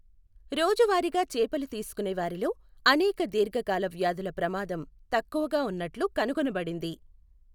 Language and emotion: Telugu, neutral